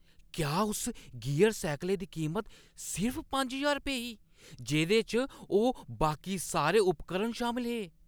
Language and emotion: Dogri, surprised